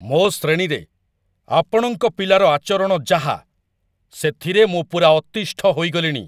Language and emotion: Odia, angry